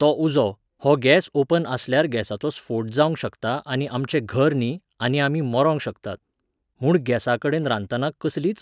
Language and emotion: Goan Konkani, neutral